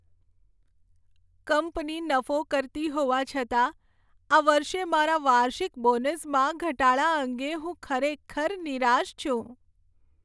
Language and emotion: Gujarati, sad